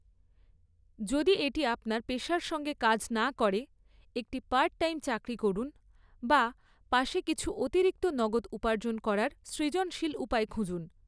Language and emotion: Bengali, neutral